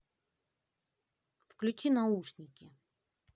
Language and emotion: Russian, angry